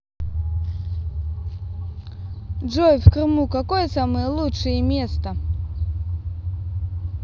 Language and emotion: Russian, positive